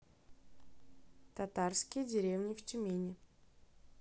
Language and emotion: Russian, neutral